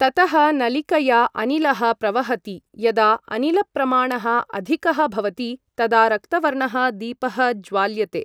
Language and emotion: Sanskrit, neutral